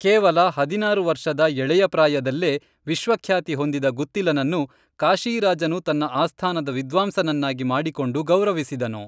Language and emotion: Kannada, neutral